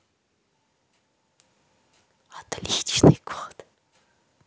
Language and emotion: Russian, positive